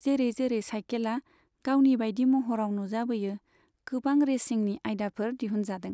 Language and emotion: Bodo, neutral